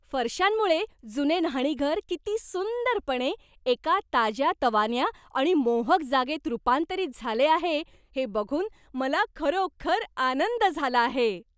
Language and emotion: Marathi, happy